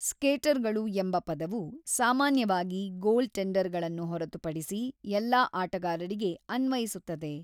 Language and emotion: Kannada, neutral